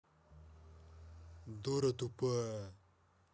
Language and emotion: Russian, angry